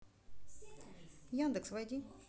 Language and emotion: Russian, neutral